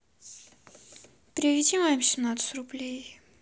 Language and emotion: Russian, sad